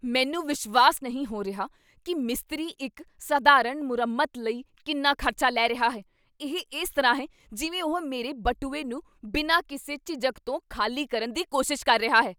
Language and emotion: Punjabi, angry